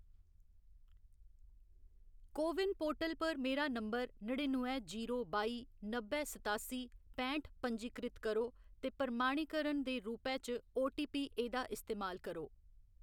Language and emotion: Dogri, neutral